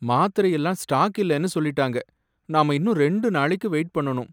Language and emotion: Tamil, sad